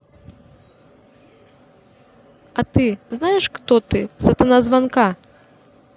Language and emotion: Russian, neutral